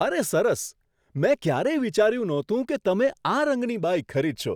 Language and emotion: Gujarati, surprised